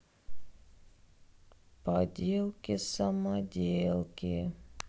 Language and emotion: Russian, sad